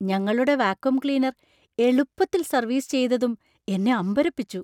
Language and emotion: Malayalam, surprised